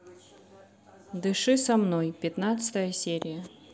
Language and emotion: Russian, neutral